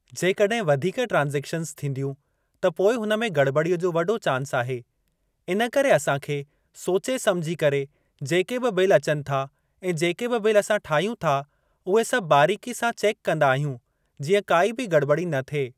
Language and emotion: Sindhi, neutral